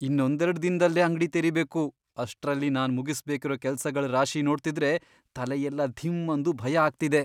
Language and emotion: Kannada, fearful